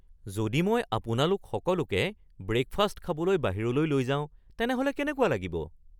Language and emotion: Assamese, surprised